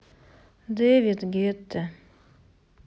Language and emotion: Russian, sad